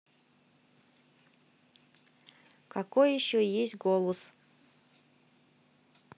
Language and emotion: Russian, neutral